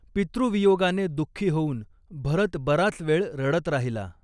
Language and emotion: Marathi, neutral